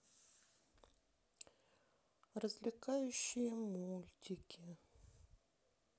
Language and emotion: Russian, sad